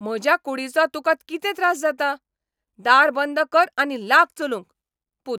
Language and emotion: Goan Konkani, angry